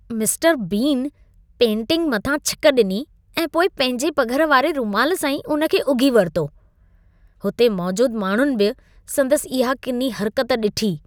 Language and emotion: Sindhi, disgusted